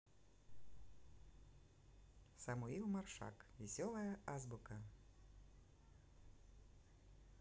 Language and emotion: Russian, neutral